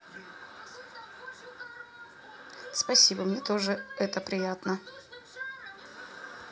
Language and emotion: Russian, neutral